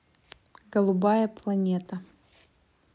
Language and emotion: Russian, neutral